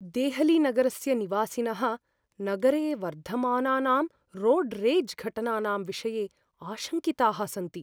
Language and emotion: Sanskrit, fearful